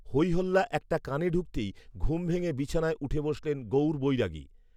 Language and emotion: Bengali, neutral